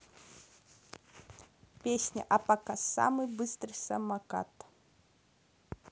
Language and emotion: Russian, neutral